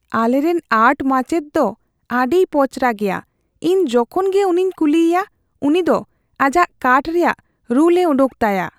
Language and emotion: Santali, fearful